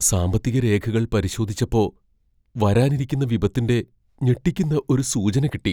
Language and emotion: Malayalam, fearful